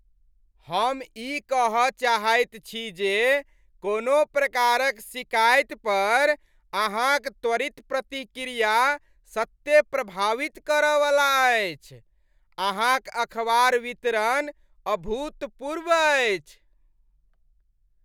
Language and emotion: Maithili, happy